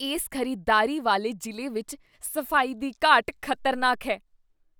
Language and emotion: Punjabi, disgusted